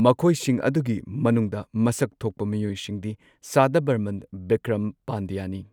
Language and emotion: Manipuri, neutral